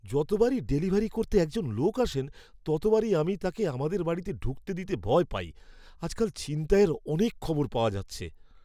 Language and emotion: Bengali, fearful